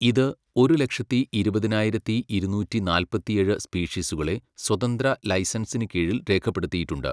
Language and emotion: Malayalam, neutral